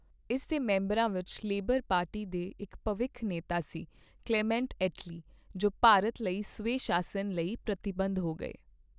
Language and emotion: Punjabi, neutral